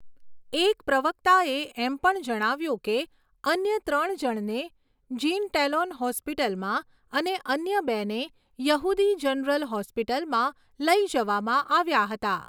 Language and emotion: Gujarati, neutral